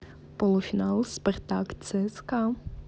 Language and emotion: Russian, positive